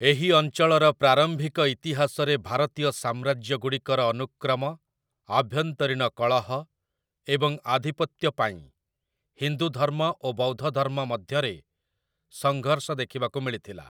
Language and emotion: Odia, neutral